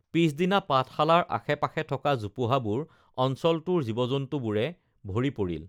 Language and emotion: Assamese, neutral